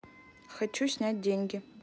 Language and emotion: Russian, neutral